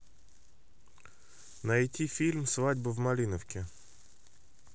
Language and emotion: Russian, neutral